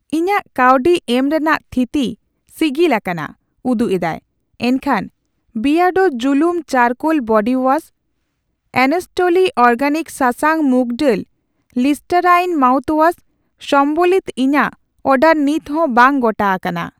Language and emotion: Santali, neutral